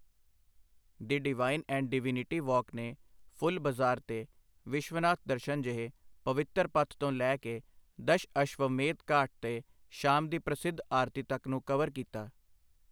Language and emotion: Punjabi, neutral